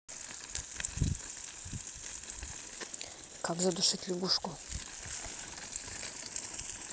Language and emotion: Russian, neutral